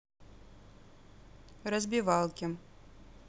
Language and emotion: Russian, neutral